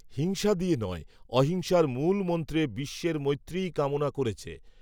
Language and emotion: Bengali, neutral